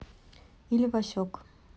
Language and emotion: Russian, neutral